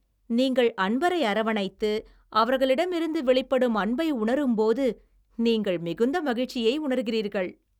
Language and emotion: Tamil, happy